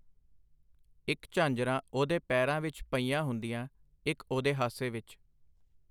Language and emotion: Punjabi, neutral